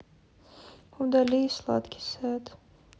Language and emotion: Russian, sad